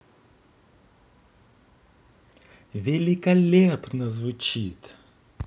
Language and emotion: Russian, positive